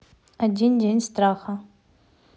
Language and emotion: Russian, neutral